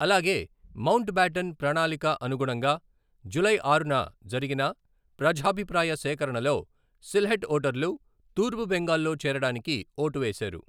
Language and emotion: Telugu, neutral